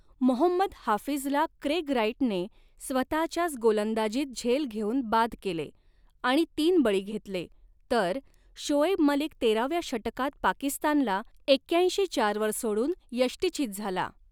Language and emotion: Marathi, neutral